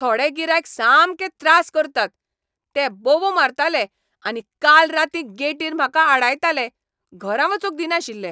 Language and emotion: Goan Konkani, angry